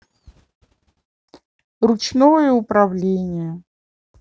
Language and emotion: Russian, neutral